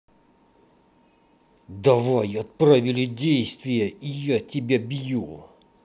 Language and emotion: Russian, angry